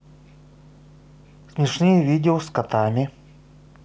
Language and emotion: Russian, neutral